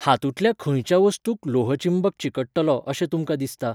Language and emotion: Goan Konkani, neutral